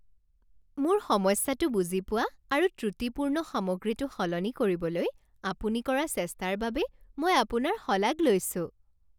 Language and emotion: Assamese, happy